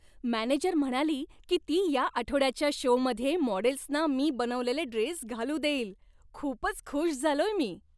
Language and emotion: Marathi, happy